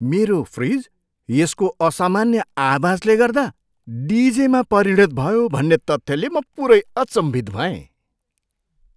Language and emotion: Nepali, surprised